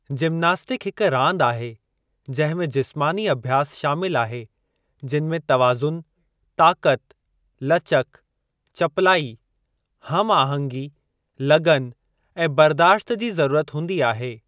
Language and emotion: Sindhi, neutral